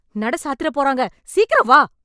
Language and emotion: Tamil, angry